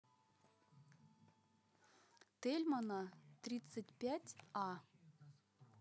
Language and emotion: Russian, neutral